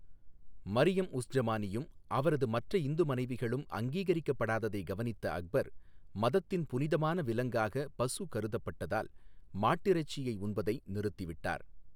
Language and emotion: Tamil, neutral